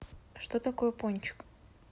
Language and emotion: Russian, neutral